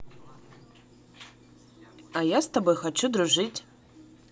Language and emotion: Russian, positive